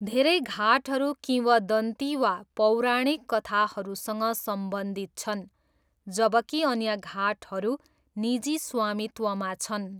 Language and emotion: Nepali, neutral